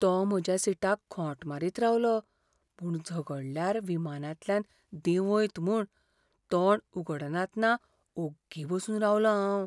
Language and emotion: Goan Konkani, fearful